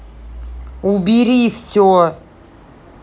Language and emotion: Russian, angry